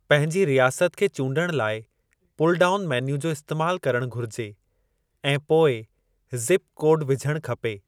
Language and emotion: Sindhi, neutral